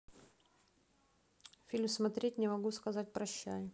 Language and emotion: Russian, neutral